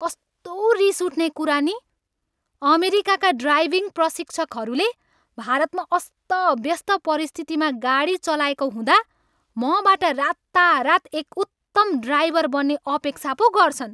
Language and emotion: Nepali, angry